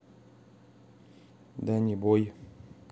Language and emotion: Russian, neutral